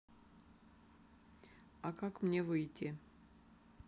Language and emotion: Russian, neutral